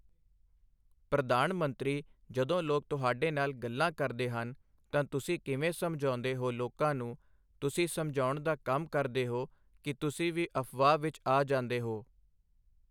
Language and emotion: Punjabi, neutral